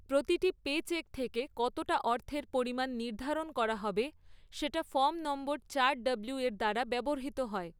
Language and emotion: Bengali, neutral